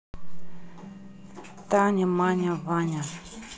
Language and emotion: Russian, neutral